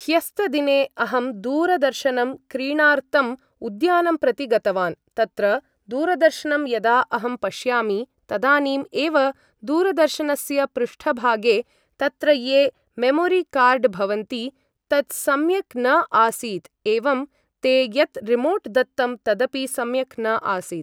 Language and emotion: Sanskrit, neutral